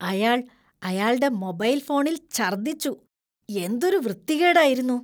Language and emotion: Malayalam, disgusted